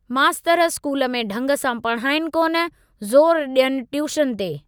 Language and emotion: Sindhi, neutral